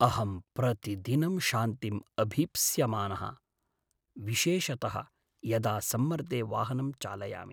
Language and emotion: Sanskrit, sad